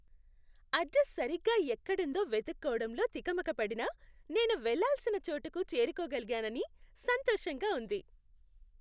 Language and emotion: Telugu, happy